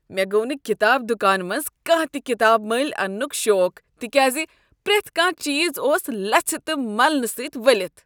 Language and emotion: Kashmiri, disgusted